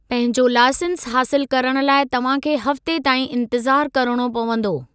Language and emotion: Sindhi, neutral